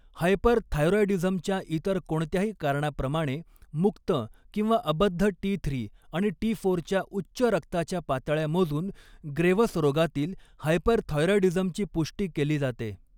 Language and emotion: Marathi, neutral